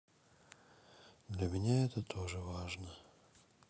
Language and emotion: Russian, sad